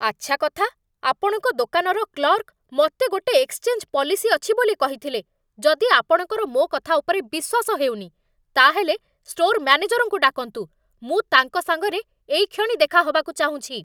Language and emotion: Odia, angry